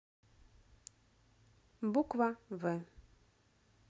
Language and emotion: Russian, neutral